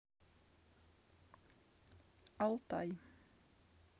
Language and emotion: Russian, neutral